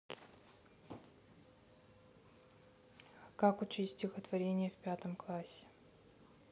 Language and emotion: Russian, neutral